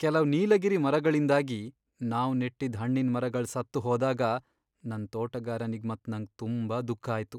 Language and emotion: Kannada, sad